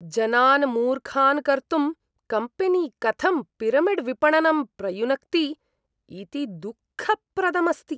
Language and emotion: Sanskrit, disgusted